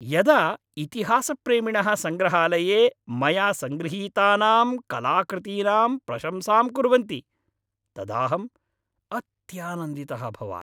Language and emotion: Sanskrit, happy